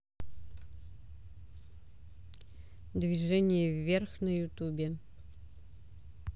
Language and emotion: Russian, neutral